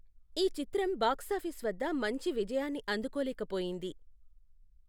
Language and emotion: Telugu, neutral